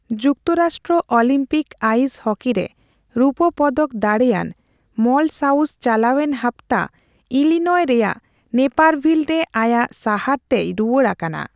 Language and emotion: Santali, neutral